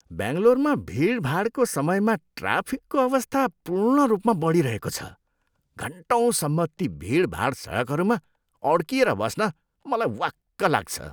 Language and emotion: Nepali, disgusted